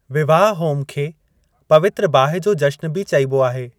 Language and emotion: Sindhi, neutral